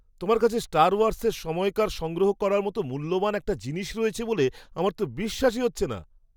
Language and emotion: Bengali, surprised